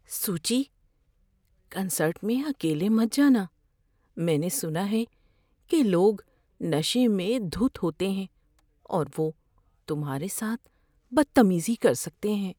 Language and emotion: Urdu, fearful